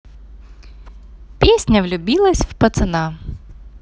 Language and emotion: Russian, positive